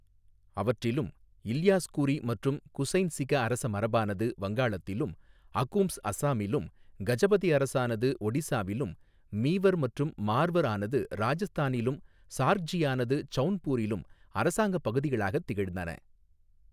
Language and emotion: Tamil, neutral